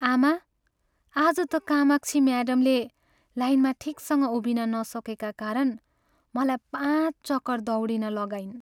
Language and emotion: Nepali, sad